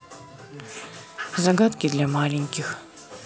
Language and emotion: Russian, neutral